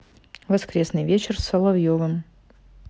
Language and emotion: Russian, neutral